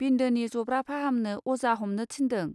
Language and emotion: Bodo, neutral